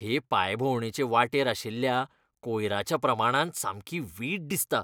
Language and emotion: Goan Konkani, disgusted